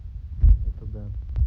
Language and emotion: Russian, neutral